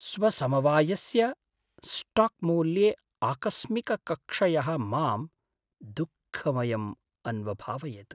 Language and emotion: Sanskrit, sad